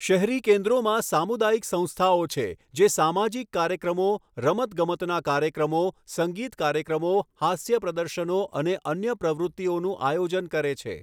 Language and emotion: Gujarati, neutral